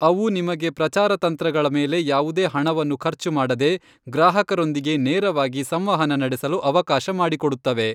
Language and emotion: Kannada, neutral